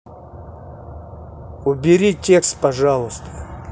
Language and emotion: Russian, angry